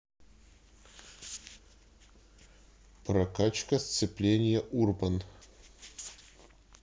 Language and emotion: Russian, neutral